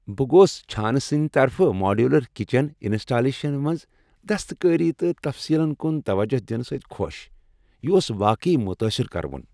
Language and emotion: Kashmiri, happy